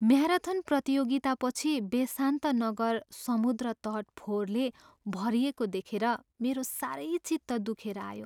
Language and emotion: Nepali, sad